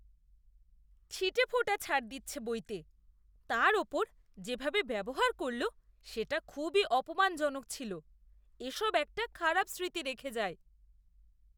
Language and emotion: Bengali, disgusted